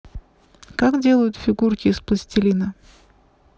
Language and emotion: Russian, neutral